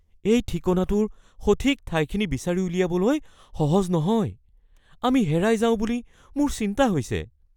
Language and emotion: Assamese, fearful